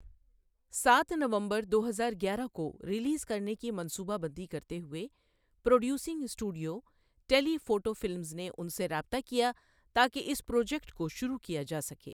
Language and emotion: Urdu, neutral